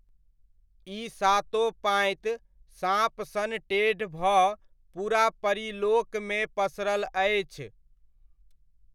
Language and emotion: Maithili, neutral